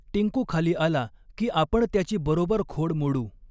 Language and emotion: Marathi, neutral